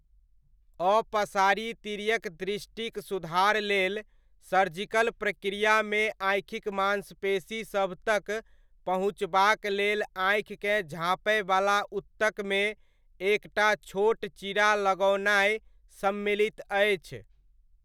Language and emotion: Maithili, neutral